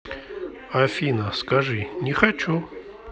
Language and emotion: Russian, neutral